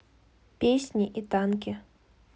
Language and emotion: Russian, neutral